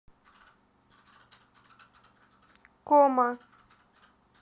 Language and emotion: Russian, neutral